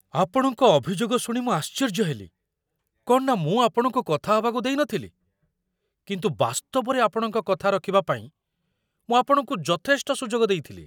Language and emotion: Odia, surprised